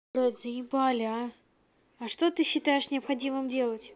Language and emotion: Russian, angry